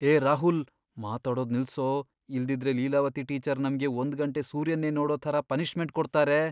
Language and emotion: Kannada, fearful